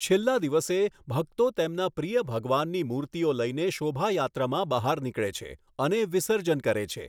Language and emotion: Gujarati, neutral